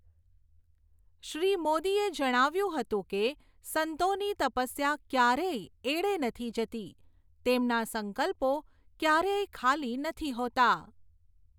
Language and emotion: Gujarati, neutral